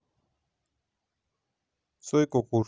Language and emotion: Russian, neutral